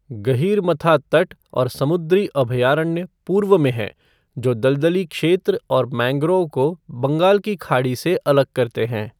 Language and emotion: Hindi, neutral